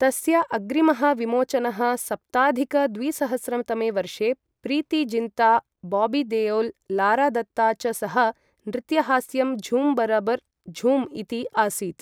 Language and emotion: Sanskrit, neutral